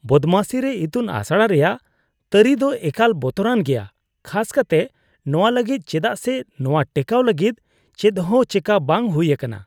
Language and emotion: Santali, disgusted